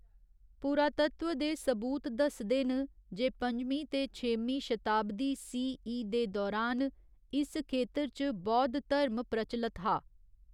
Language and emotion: Dogri, neutral